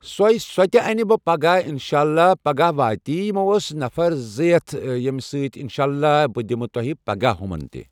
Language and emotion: Kashmiri, neutral